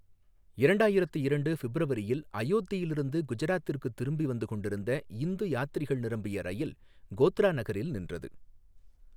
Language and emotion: Tamil, neutral